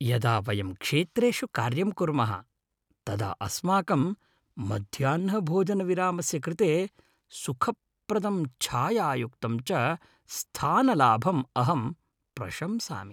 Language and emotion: Sanskrit, happy